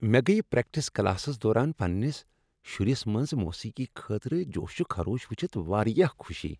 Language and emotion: Kashmiri, happy